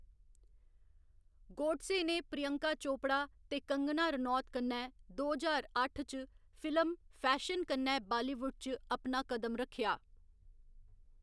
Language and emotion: Dogri, neutral